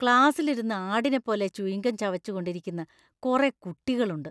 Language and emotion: Malayalam, disgusted